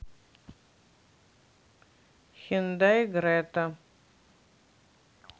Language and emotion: Russian, neutral